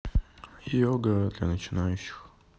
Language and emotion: Russian, neutral